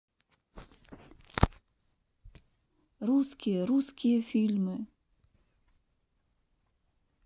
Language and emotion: Russian, neutral